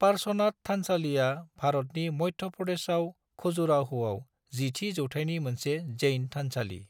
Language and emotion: Bodo, neutral